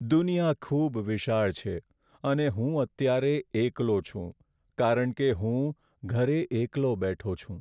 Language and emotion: Gujarati, sad